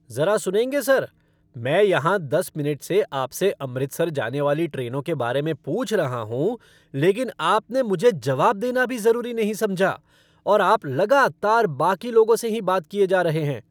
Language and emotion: Hindi, angry